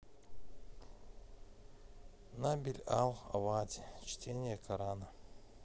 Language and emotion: Russian, neutral